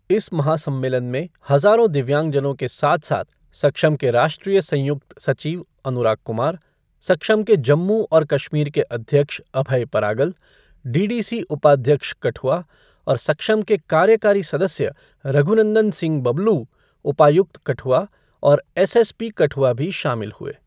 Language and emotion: Hindi, neutral